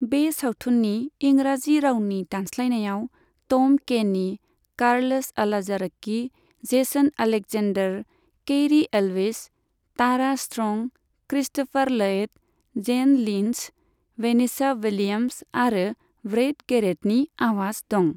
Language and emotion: Bodo, neutral